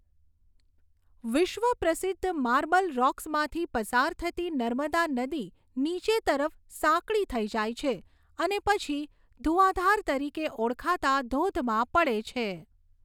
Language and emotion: Gujarati, neutral